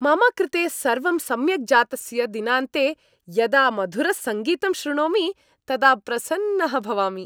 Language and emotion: Sanskrit, happy